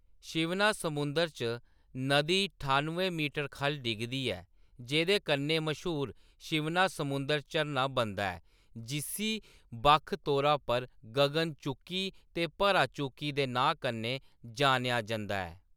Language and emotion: Dogri, neutral